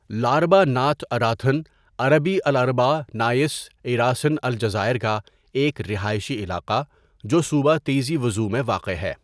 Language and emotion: Urdu, neutral